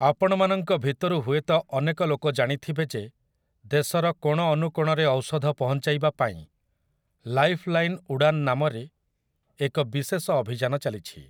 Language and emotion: Odia, neutral